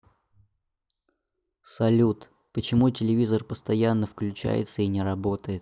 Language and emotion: Russian, neutral